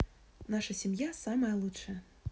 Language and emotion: Russian, positive